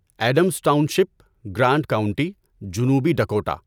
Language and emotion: Urdu, neutral